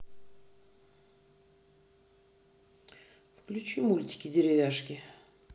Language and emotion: Russian, neutral